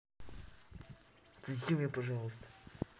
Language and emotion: Russian, neutral